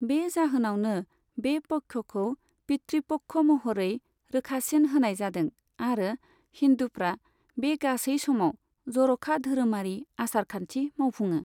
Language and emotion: Bodo, neutral